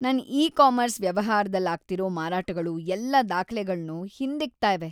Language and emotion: Kannada, happy